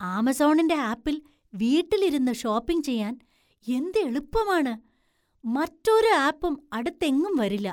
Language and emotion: Malayalam, surprised